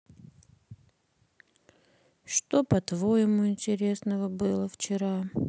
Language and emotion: Russian, sad